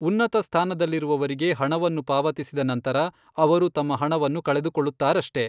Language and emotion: Kannada, neutral